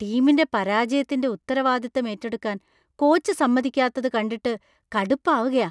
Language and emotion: Malayalam, disgusted